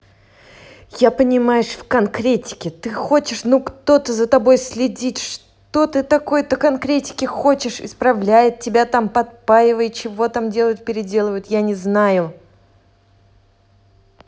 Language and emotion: Russian, angry